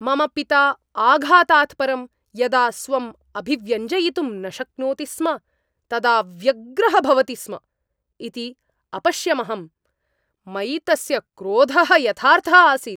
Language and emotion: Sanskrit, angry